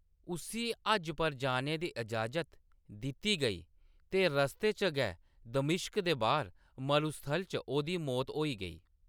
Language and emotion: Dogri, neutral